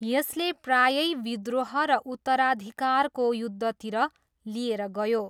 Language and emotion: Nepali, neutral